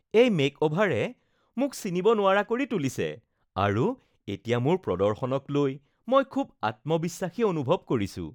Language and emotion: Assamese, happy